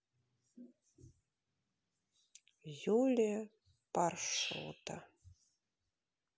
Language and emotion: Russian, neutral